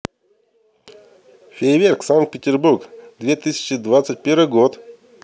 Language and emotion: Russian, neutral